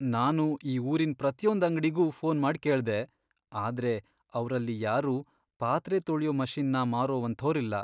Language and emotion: Kannada, sad